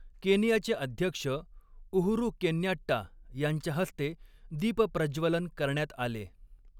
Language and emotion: Marathi, neutral